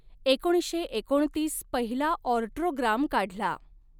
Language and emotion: Marathi, neutral